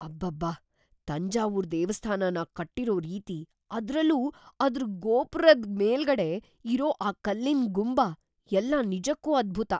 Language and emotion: Kannada, surprised